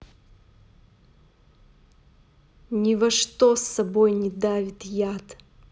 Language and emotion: Russian, angry